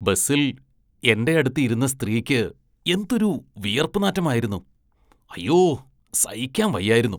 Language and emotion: Malayalam, disgusted